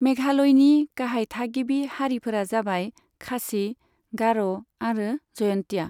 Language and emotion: Bodo, neutral